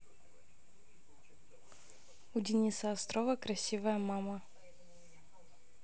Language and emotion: Russian, neutral